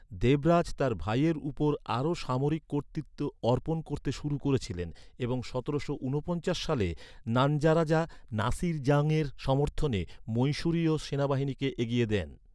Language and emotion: Bengali, neutral